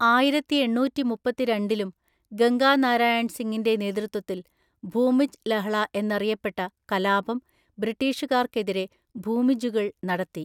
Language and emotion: Malayalam, neutral